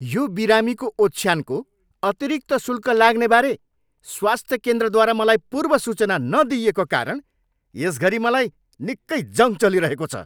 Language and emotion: Nepali, angry